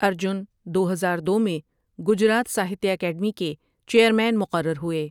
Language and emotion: Urdu, neutral